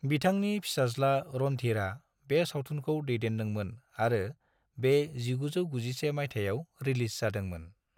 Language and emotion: Bodo, neutral